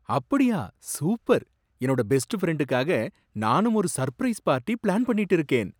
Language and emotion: Tamil, surprised